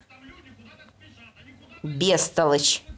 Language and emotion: Russian, angry